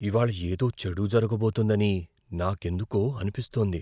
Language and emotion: Telugu, fearful